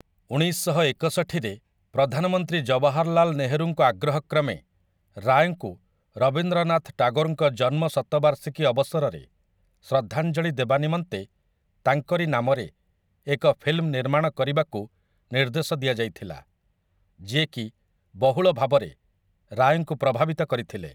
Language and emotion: Odia, neutral